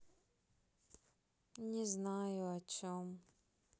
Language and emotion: Russian, sad